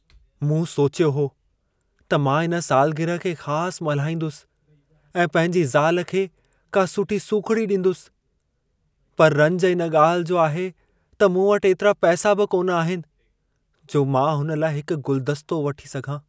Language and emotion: Sindhi, sad